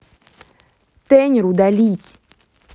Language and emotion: Russian, angry